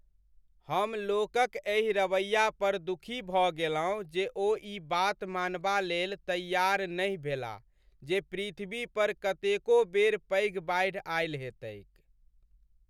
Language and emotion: Maithili, sad